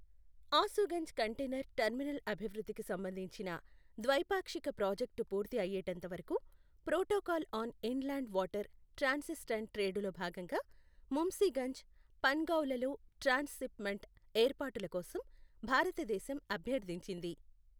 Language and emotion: Telugu, neutral